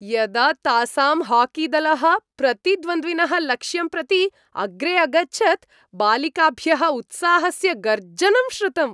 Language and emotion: Sanskrit, happy